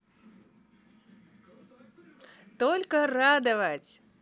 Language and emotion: Russian, positive